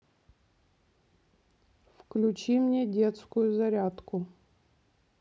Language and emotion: Russian, neutral